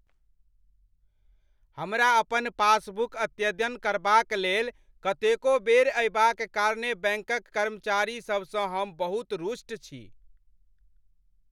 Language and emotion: Maithili, angry